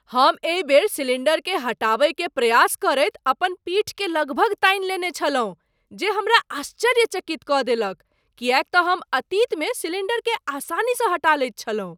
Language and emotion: Maithili, surprised